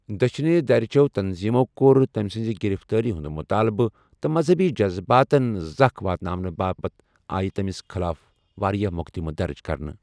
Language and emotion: Kashmiri, neutral